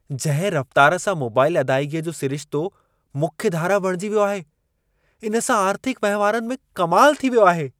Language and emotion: Sindhi, surprised